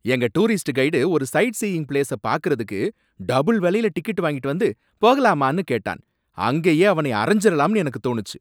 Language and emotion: Tamil, angry